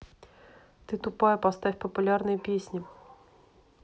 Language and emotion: Russian, angry